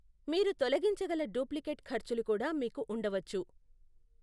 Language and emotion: Telugu, neutral